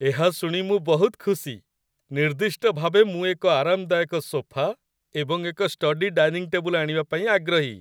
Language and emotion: Odia, happy